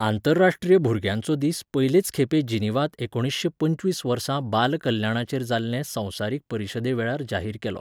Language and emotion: Goan Konkani, neutral